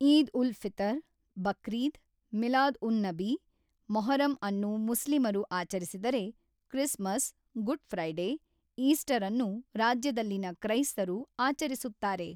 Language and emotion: Kannada, neutral